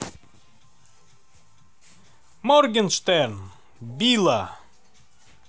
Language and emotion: Russian, positive